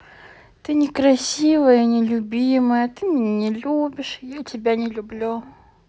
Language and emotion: Russian, sad